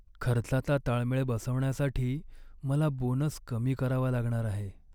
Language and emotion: Marathi, sad